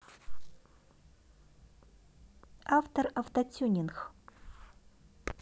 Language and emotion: Russian, neutral